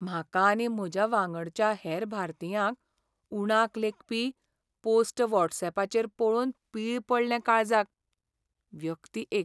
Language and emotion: Goan Konkani, sad